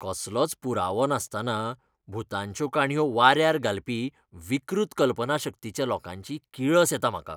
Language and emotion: Goan Konkani, disgusted